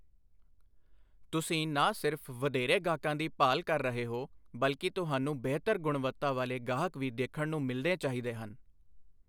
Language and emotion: Punjabi, neutral